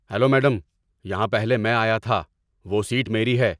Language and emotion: Urdu, angry